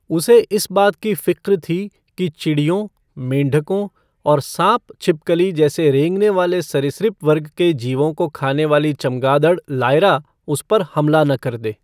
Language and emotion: Hindi, neutral